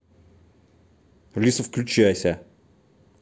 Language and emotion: Russian, angry